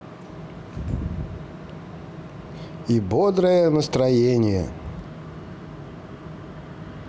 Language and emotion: Russian, positive